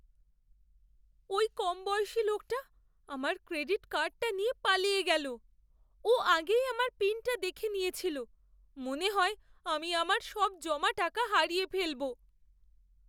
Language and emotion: Bengali, fearful